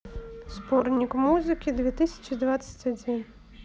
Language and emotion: Russian, neutral